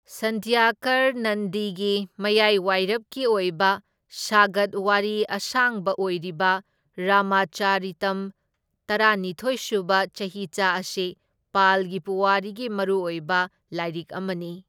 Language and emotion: Manipuri, neutral